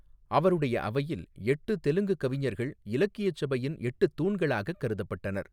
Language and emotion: Tamil, neutral